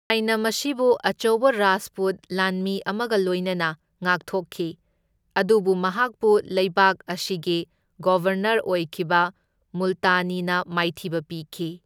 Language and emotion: Manipuri, neutral